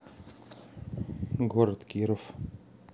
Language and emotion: Russian, neutral